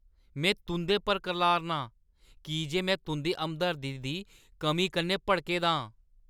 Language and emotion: Dogri, angry